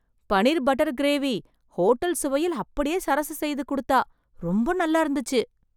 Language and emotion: Tamil, surprised